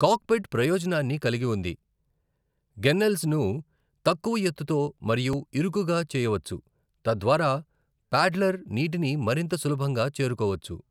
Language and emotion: Telugu, neutral